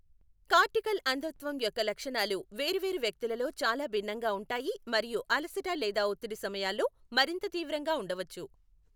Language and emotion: Telugu, neutral